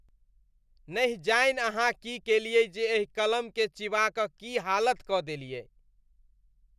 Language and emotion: Maithili, disgusted